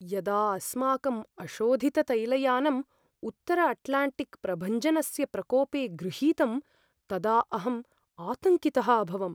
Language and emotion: Sanskrit, fearful